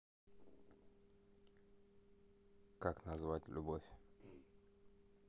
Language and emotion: Russian, neutral